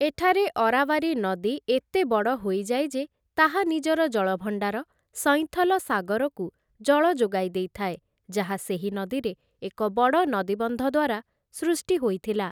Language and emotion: Odia, neutral